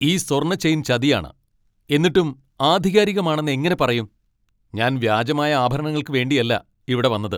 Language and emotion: Malayalam, angry